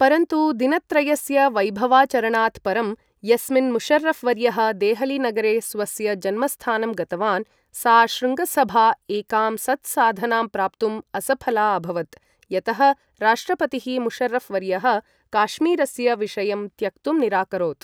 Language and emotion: Sanskrit, neutral